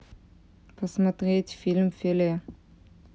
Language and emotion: Russian, neutral